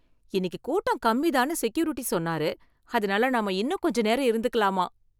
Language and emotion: Tamil, happy